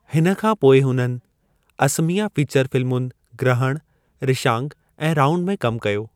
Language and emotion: Sindhi, neutral